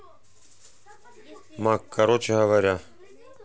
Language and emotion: Russian, neutral